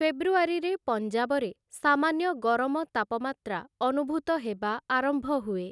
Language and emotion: Odia, neutral